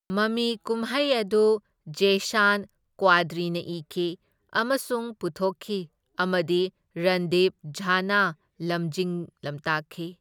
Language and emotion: Manipuri, neutral